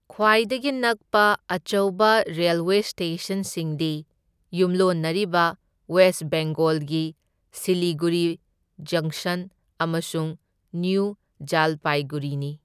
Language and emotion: Manipuri, neutral